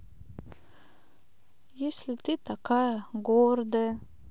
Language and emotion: Russian, sad